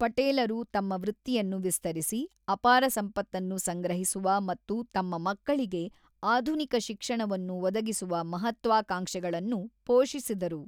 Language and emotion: Kannada, neutral